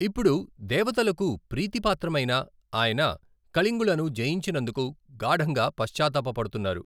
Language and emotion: Telugu, neutral